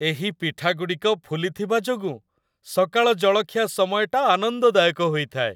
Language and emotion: Odia, happy